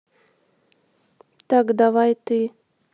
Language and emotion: Russian, neutral